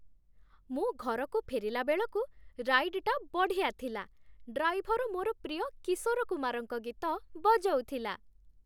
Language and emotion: Odia, happy